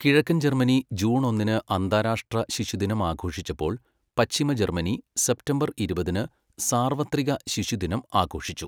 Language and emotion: Malayalam, neutral